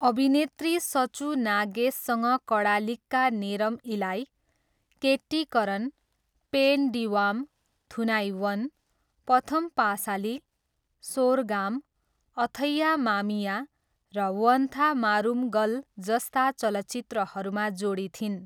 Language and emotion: Nepali, neutral